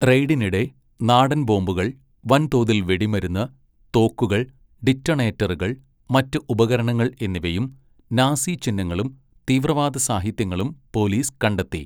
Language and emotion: Malayalam, neutral